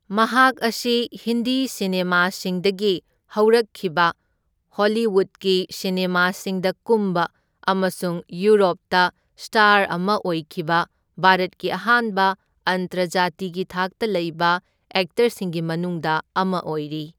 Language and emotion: Manipuri, neutral